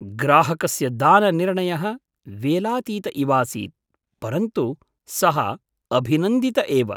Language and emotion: Sanskrit, surprised